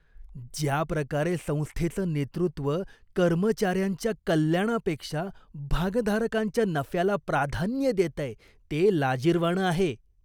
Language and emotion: Marathi, disgusted